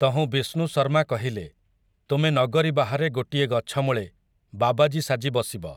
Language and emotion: Odia, neutral